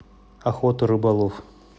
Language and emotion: Russian, neutral